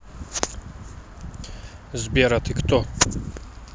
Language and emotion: Russian, neutral